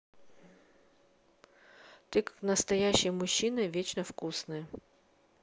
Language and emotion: Russian, neutral